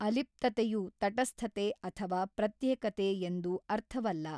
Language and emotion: Kannada, neutral